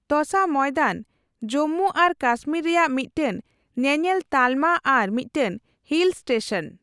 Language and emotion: Santali, neutral